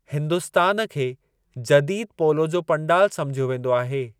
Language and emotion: Sindhi, neutral